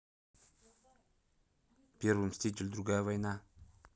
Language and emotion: Russian, neutral